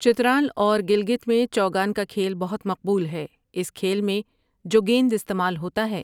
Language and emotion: Urdu, neutral